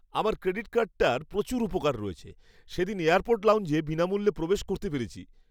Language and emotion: Bengali, happy